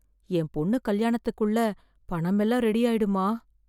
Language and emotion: Tamil, fearful